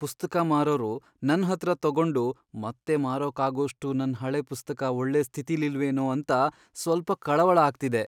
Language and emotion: Kannada, fearful